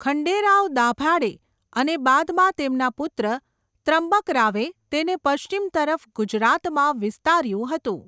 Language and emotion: Gujarati, neutral